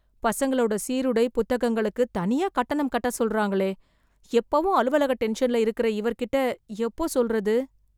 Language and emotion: Tamil, fearful